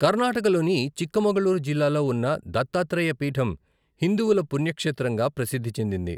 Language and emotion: Telugu, neutral